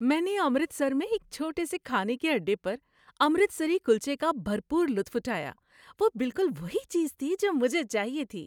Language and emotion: Urdu, happy